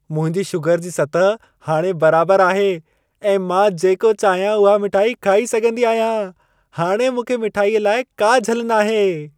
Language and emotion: Sindhi, happy